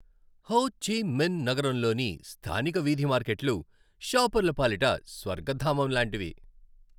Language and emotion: Telugu, happy